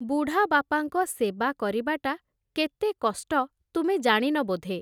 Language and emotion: Odia, neutral